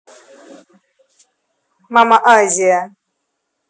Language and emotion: Russian, neutral